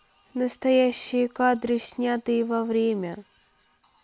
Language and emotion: Russian, neutral